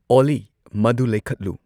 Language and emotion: Manipuri, neutral